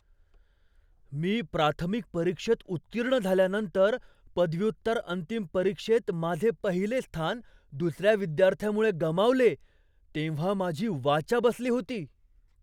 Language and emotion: Marathi, surprised